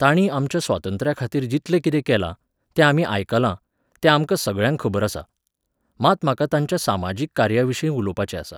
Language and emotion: Goan Konkani, neutral